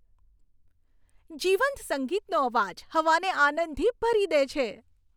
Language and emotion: Gujarati, happy